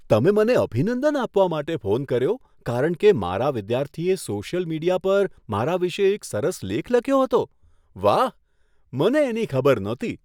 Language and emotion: Gujarati, surprised